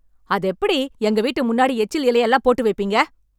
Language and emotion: Tamil, angry